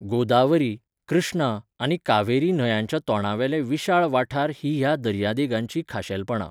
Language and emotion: Goan Konkani, neutral